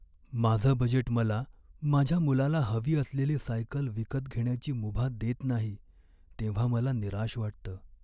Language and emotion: Marathi, sad